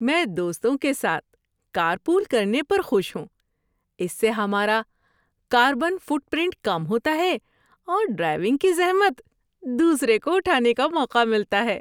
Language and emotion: Urdu, happy